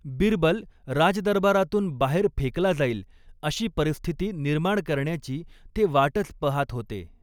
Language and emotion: Marathi, neutral